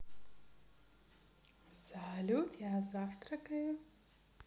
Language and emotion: Russian, positive